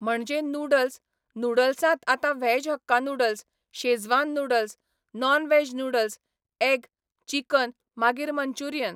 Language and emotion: Goan Konkani, neutral